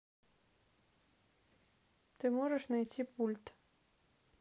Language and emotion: Russian, neutral